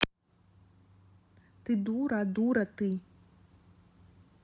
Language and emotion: Russian, angry